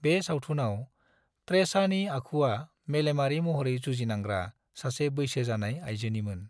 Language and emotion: Bodo, neutral